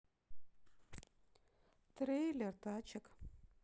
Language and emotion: Russian, neutral